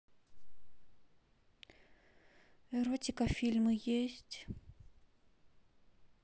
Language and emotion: Russian, sad